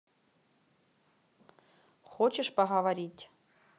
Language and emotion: Russian, neutral